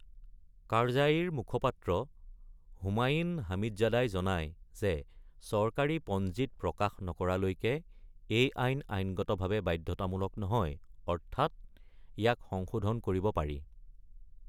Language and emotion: Assamese, neutral